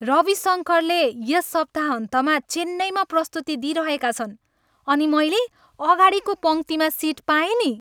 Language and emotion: Nepali, happy